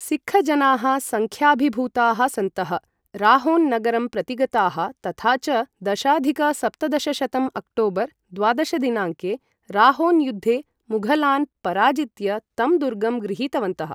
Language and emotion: Sanskrit, neutral